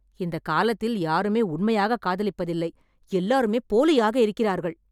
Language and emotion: Tamil, angry